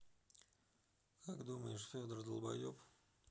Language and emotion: Russian, neutral